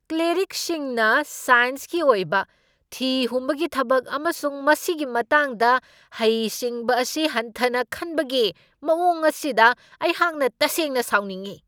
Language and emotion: Manipuri, angry